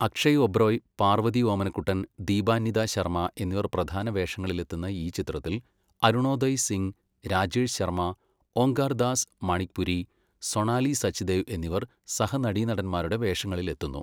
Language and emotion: Malayalam, neutral